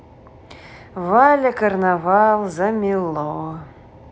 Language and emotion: Russian, neutral